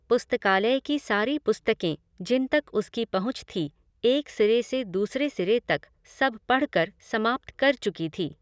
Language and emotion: Hindi, neutral